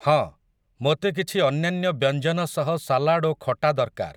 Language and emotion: Odia, neutral